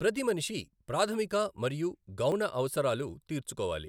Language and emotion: Telugu, neutral